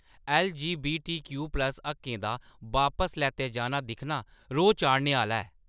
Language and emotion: Dogri, angry